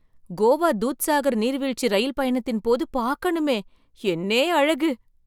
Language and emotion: Tamil, surprised